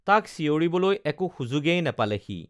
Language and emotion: Assamese, neutral